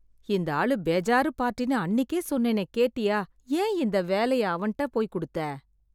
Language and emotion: Tamil, sad